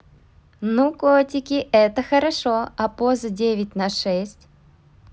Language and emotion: Russian, positive